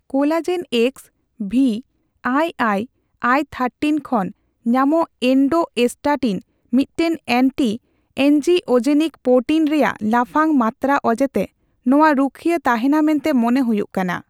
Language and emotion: Santali, neutral